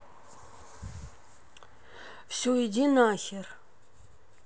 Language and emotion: Russian, angry